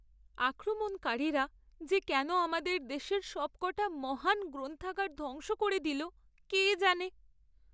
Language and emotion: Bengali, sad